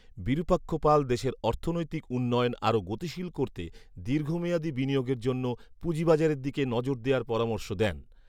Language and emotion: Bengali, neutral